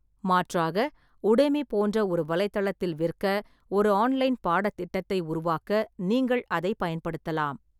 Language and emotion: Tamil, neutral